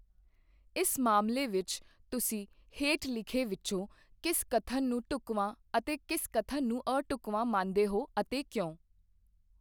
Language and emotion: Punjabi, neutral